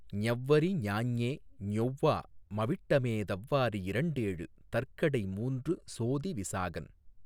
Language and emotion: Tamil, neutral